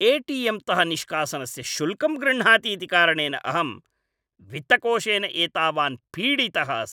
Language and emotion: Sanskrit, angry